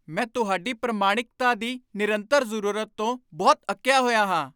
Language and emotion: Punjabi, angry